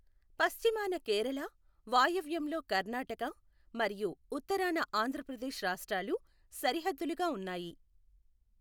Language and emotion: Telugu, neutral